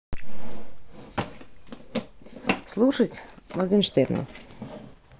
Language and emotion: Russian, neutral